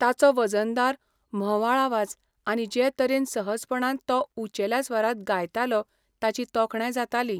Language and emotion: Goan Konkani, neutral